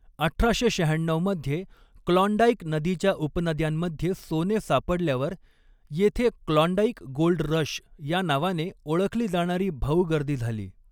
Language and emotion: Marathi, neutral